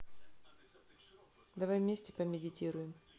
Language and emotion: Russian, neutral